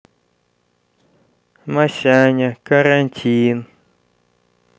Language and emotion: Russian, neutral